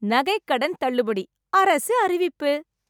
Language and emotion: Tamil, happy